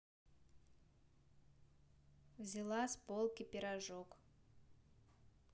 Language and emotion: Russian, neutral